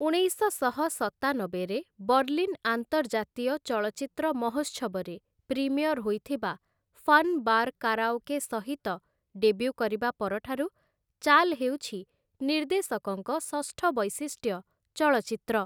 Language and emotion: Odia, neutral